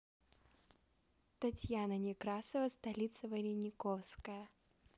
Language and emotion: Russian, neutral